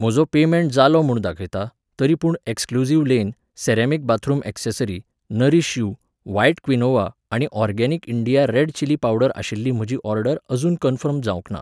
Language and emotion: Goan Konkani, neutral